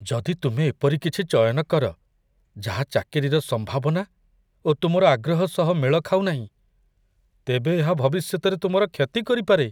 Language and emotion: Odia, fearful